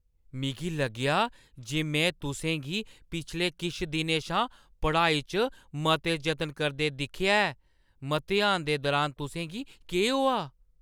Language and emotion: Dogri, surprised